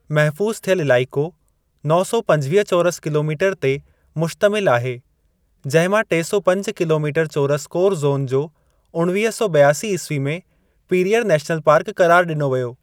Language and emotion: Sindhi, neutral